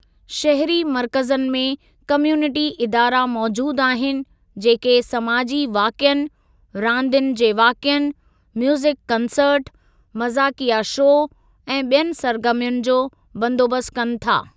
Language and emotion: Sindhi, neutral